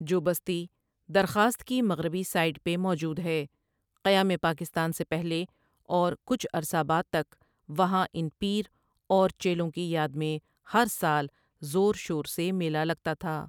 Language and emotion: Urdu, neutral